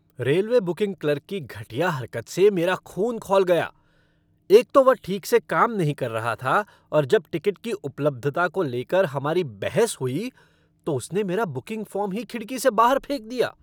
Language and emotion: Hindi, angry